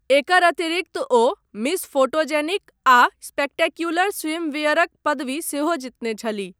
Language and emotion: Maithili, neutral